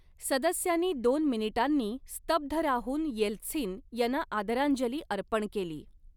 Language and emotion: Marathi, neutral